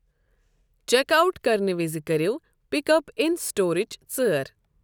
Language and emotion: Kashmiri, neutral